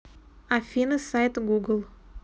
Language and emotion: Russian, neutral